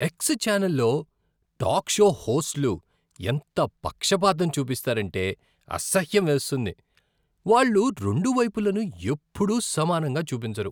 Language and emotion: Telugu, disgusted